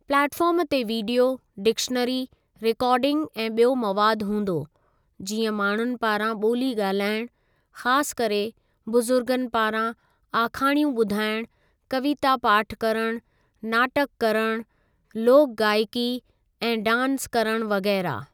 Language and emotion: Sindhi, neutral